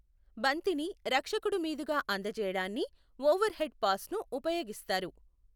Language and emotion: Telugu, neutral